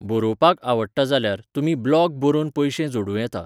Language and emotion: Goan Konkani, neutral